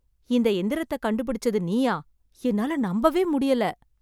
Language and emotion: Tamil, surprised